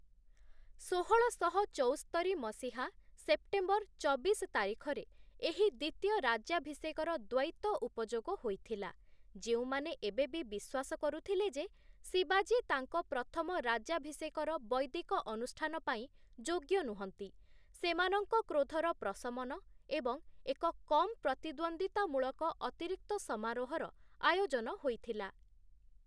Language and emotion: Odia, neutral